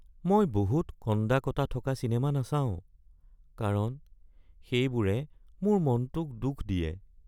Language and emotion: Assamese, sad